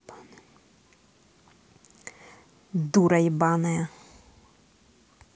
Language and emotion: Russian, angry